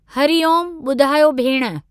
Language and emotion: Sindhi, neutral